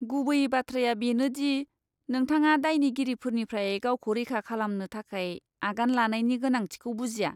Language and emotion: Bodo, disgusted